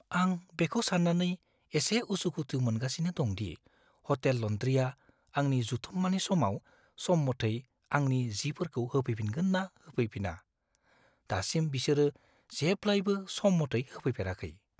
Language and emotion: Bodo, fearful